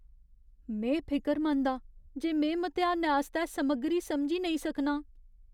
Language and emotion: Dogri, fearful